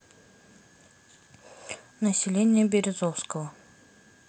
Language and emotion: Russian, neutral